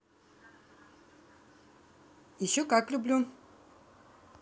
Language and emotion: Russian, positive